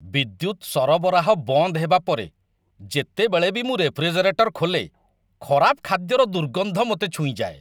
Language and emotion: Odia, disgusted